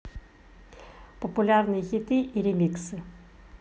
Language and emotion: Russian, neutral